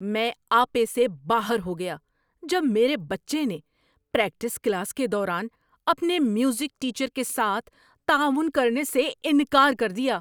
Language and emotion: Urdu, angry